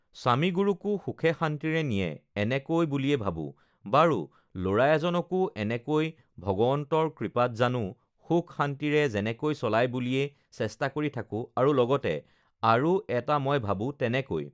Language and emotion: Assamese, neutral